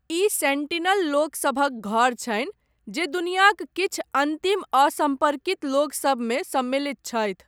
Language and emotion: Maithili, neutral